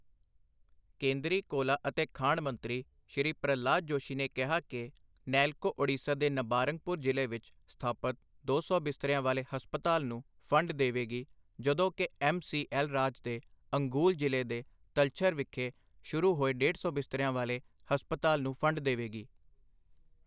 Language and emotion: Punjabi, neutral